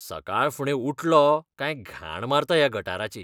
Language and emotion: Goan Konkani, disgusted